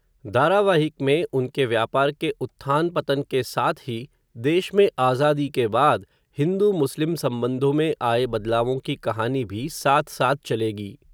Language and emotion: Hindi, neutral